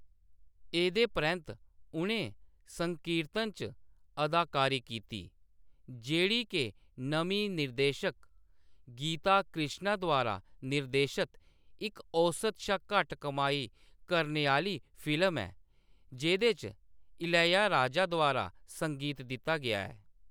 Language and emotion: Dogri, neutral